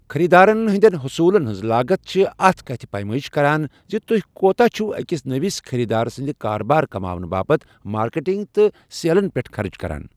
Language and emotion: Kashmiri, neutral